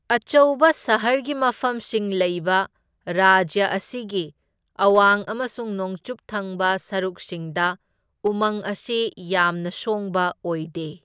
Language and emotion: Manipuri, neutral